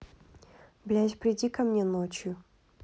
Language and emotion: Russian, angry